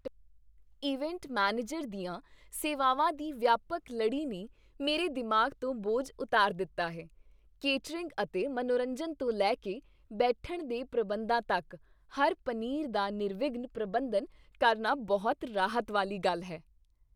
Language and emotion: Punjabi, happy